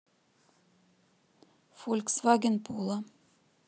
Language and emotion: Russian, neutral